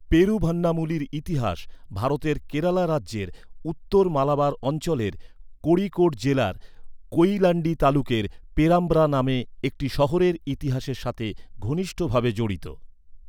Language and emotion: Bengali, neutral